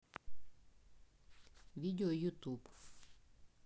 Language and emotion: Russian, neutral